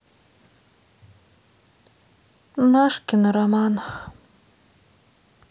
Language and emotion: Russian, sad